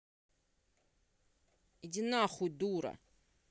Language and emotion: Russian, angry